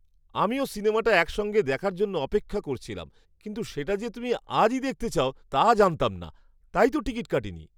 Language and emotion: Bengali, surprised